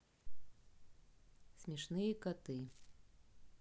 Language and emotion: Russian, neutral